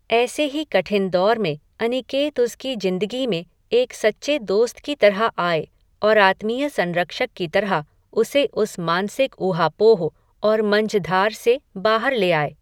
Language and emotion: Hindi, neutral